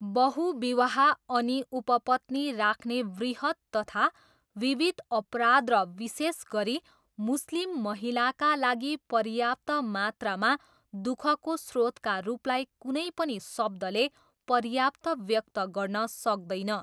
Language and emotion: Nepali, neutral